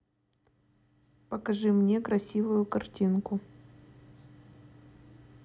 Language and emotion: Russian, neutral